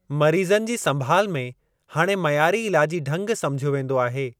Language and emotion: Sindhi, neutral